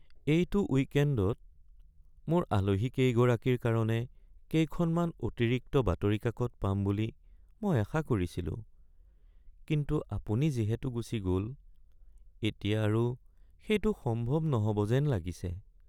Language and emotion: Assamese, sad